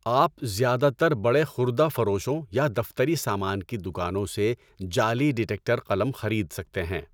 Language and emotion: Urdu, neutral